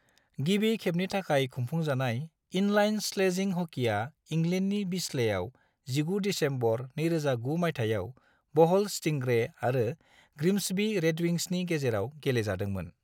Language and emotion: Bodo, neutral